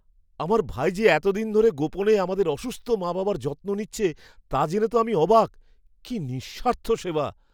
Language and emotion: Bengali, surprised